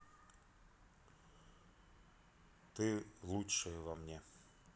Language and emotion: Russian, neutral